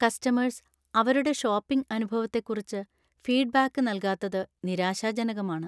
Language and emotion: Malayalam, sad